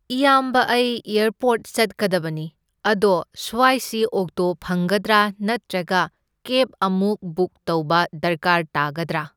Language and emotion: Manipuri, neutral